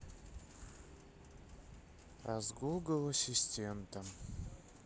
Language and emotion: Russian, sad